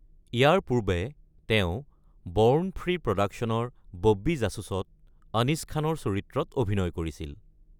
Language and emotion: Assamese, neutral